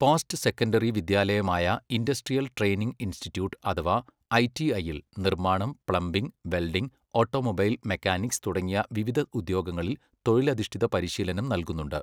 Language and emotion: Malayalam, neutral